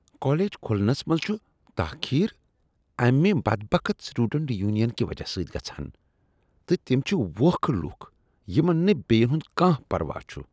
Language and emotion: Kashmiri, disgusted